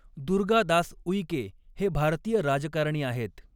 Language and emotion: Marathi, neutral